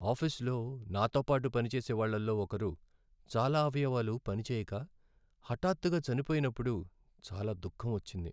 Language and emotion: Telugu, sad